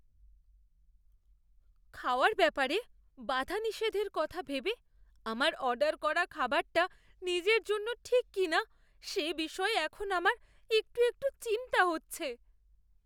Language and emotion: Bengali, fearful